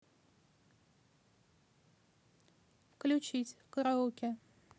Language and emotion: Russian, neutral